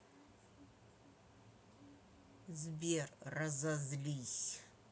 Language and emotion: Russian, angry